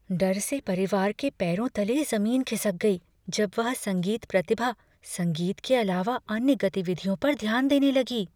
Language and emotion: Hindi, fearful